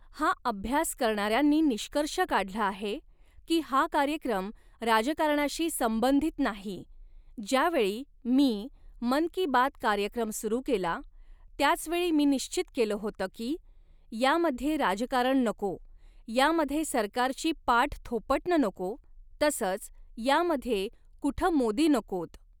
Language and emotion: Marathi, neutral